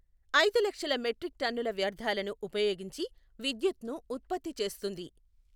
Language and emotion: Telugu, neutral